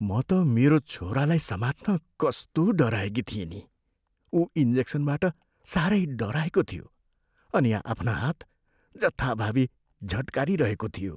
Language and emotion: Nepali, fearful